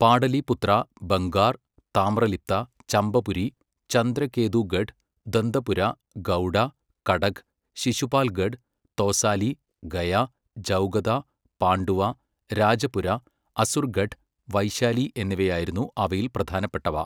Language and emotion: Malayalam, neutral